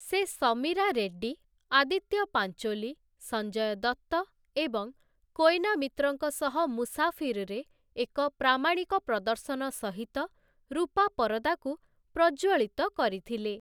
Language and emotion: Odia, neutral